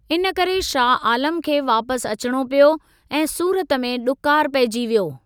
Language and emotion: Sindhi, neutral